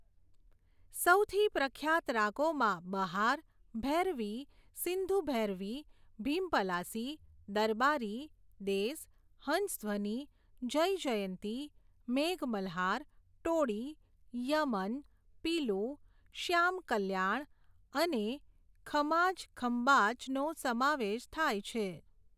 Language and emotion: Gujarati, neutral